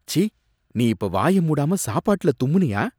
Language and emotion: Tamil, disgusted